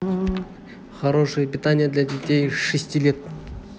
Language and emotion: Russian, neutral